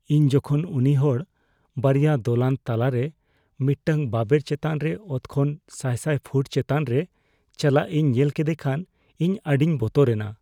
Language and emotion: Santali, fearful